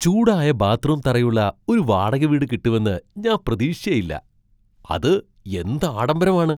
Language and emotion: Malayalam, surprised